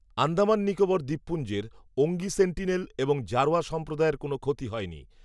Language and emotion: Bengali, neutral